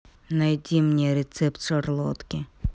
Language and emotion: Russian, neutral